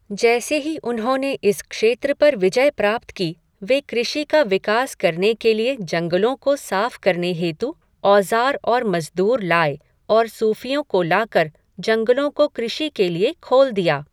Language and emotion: Hindi, neutral